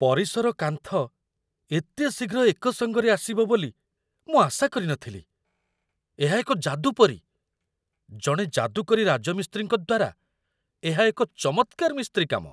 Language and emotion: Odia, surprised